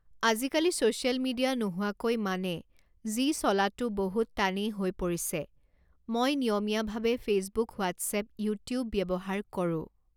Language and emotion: Assamese, neutral